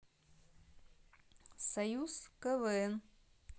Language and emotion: Russian, neutral